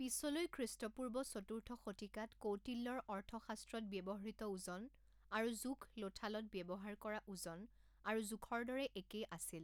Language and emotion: Assamese, neutral